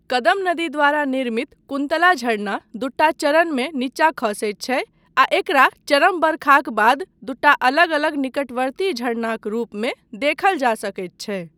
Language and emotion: Maithili, neutral